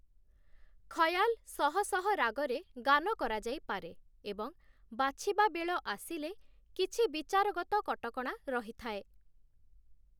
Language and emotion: Odia, neutral